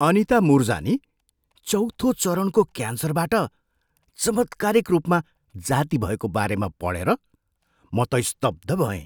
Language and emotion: Nepali, surprised